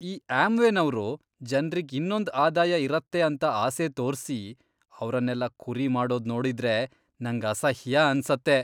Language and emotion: Kannada, disgusted